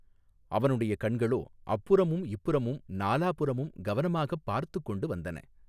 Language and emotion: Tamil, neutral